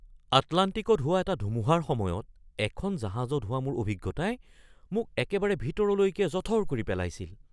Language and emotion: Assamese, surprised